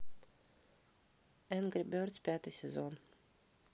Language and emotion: Russian, neutral